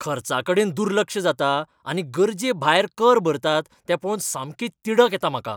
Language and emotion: Goan Konkani, angry